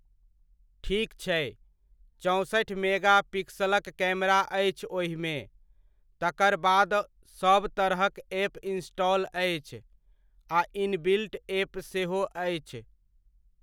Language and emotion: Maithili, neutral